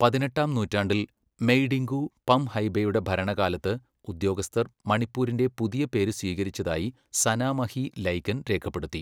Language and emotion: Malayalam, neutral